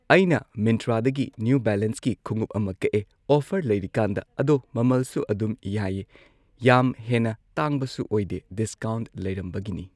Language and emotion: Manipuri, neutral